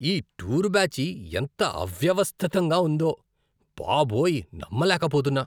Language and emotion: Telugu, disgusted